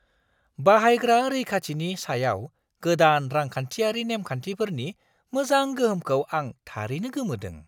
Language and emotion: Bodo, surprised